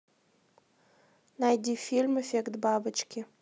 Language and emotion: Russian, neutral